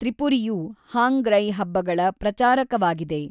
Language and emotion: Kannada, neutral